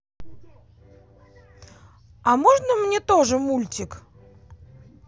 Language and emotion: Russian, positive